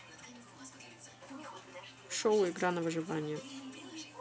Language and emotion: Russian, neutral